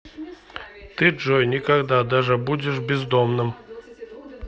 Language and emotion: Russian, neutral